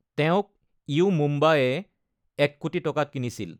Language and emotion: Assamese, neutral